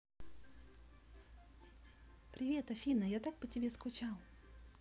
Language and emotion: Russian, positive